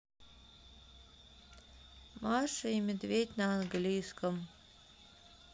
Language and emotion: Russian, sad